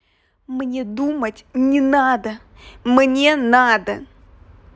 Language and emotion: Russian, angry